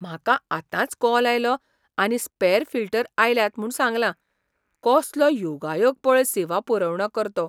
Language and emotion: Goan Konkani, surprised